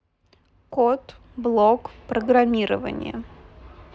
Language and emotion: Russian, neutral